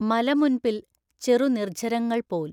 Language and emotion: Malayalam, neutral